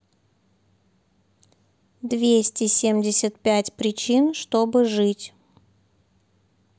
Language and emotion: Russian, neutral